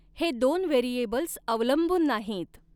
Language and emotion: Marathi, neutral